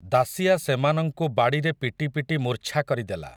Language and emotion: Odia, neutral